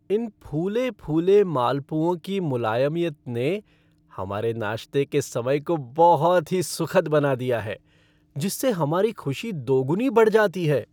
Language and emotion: Hindi, happy